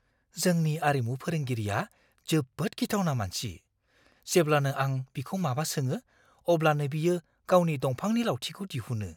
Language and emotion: Bodo, fearful